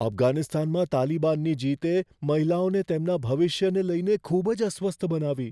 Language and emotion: Gujarati, fearful